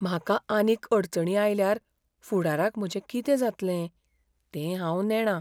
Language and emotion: Goan Konkani, fearful